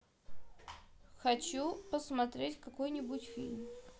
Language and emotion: Russian, neutral